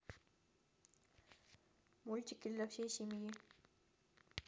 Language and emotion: Russian, neutral